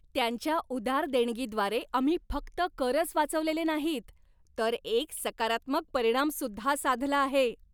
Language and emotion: Marathi, happy